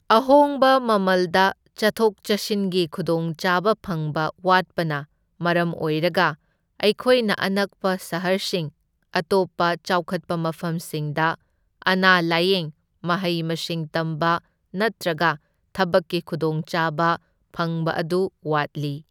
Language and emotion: Manipuri, neutral